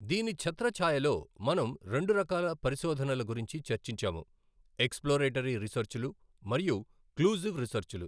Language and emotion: Telugu, neutral